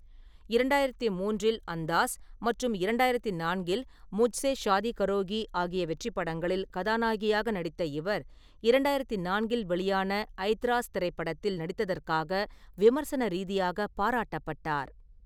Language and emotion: Tamil, neutral